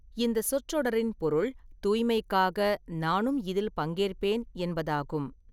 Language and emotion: Tamil, neutral